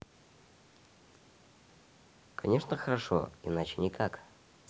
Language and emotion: Russian, positive